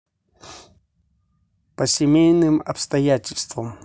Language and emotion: Russian, neutral